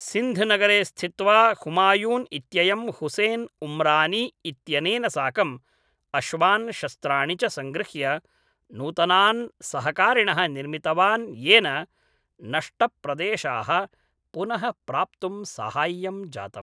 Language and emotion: Sanskrit, neutral